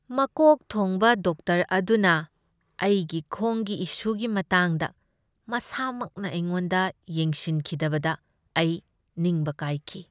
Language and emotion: Manipuri, sad